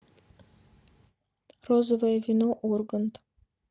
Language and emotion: Russian, neutral